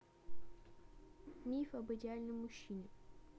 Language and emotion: Russian, neutral